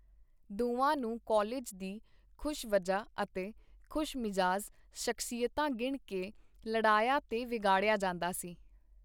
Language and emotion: Punjabi, neutral